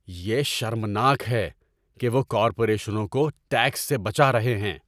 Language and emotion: Urdu, angry